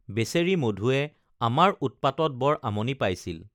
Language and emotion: Assamese, neutral